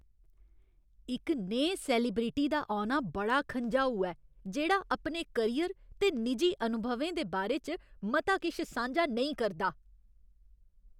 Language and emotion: Dogri, angry